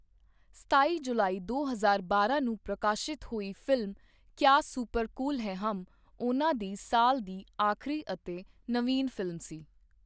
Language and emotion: Punjabi, neutral